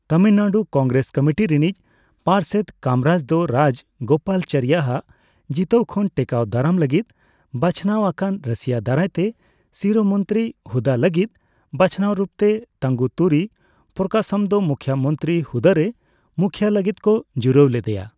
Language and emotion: Santali, neutral